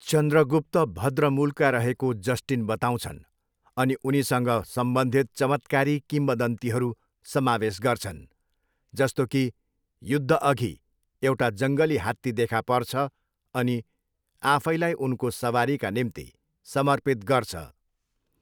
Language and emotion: Nepali, neutral